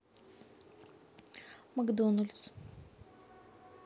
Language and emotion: Russian, neutral